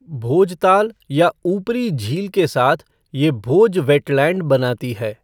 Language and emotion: Hindi, neutral